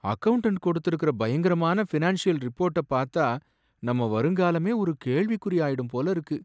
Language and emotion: Tamil, sad